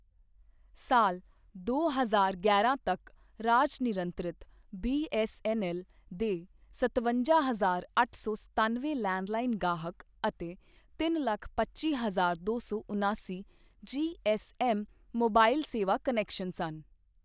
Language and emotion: Punjabi, neutral